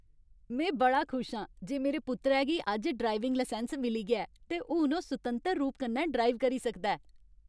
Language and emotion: Dogri, happy